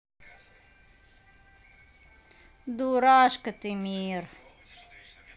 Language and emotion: Russian, positive